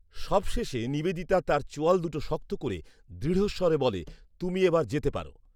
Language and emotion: Bengali, neutral